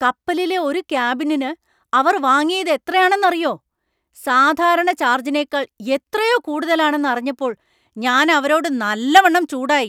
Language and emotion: Malayalam, angry